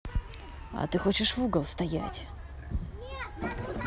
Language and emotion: Russian, angry